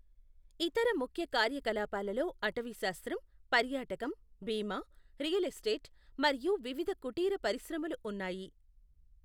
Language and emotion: Telugu, neutral